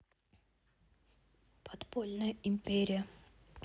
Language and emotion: Russian, neutral